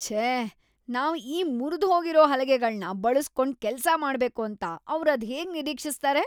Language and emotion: Kannada, disgusted